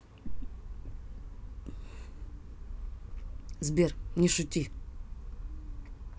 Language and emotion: Russian, neutral